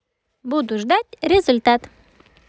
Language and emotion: Russian, positive